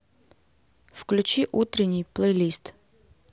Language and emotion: Russian, neutral